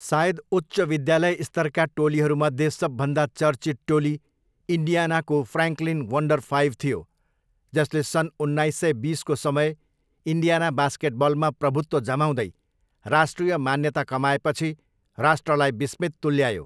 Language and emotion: Nepali, neutral